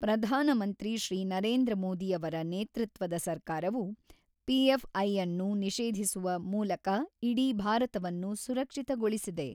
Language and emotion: Kannada, neutral